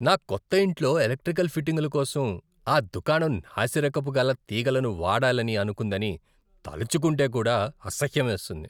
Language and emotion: Telugu, disgusted